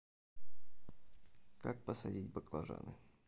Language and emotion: Russian, neutral